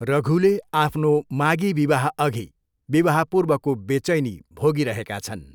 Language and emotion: Nepali, neutral